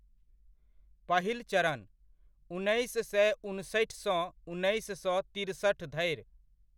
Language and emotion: Maithili, neutral